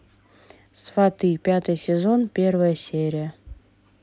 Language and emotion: Russian, neutral